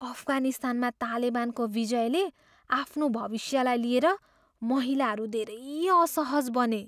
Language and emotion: Nepali, fearful